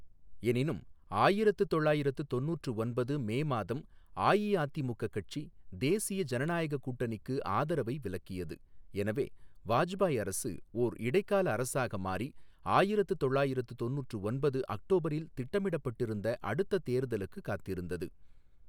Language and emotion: Tamil, neutral